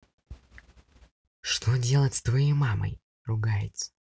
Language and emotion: Russian, neutral